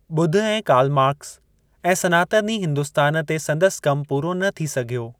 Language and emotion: Sindhi, neutral